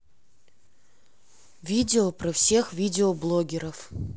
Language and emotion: Russian, neutral